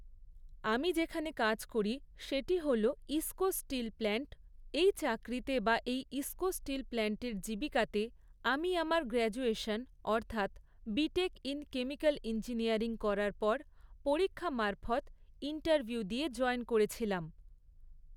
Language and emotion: Bengali, neutral